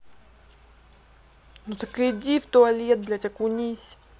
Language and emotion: Russian, angry